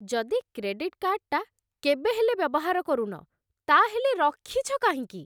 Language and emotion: Odia, disgusted